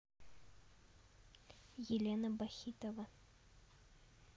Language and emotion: Russian, neutral